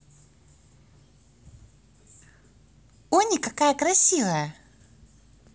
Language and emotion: Russian, positive